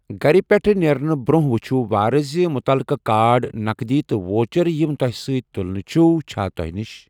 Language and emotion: Kashmiri, neutral